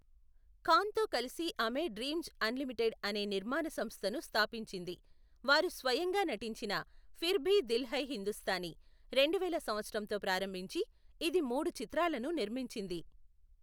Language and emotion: Telugu, neutral